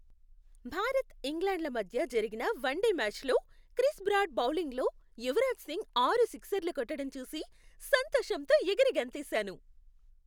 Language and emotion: Telugu, happy